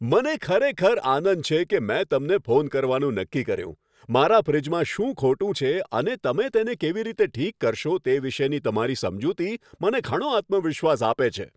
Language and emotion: Gujarati, happy